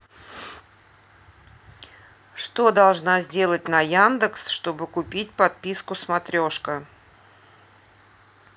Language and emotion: Russian, neutral